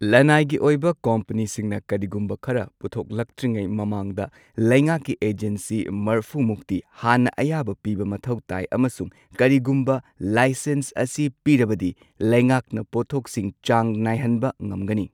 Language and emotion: Manipuri, neutral